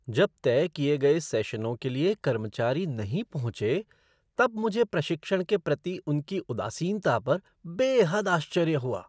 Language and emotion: Hindi, surprised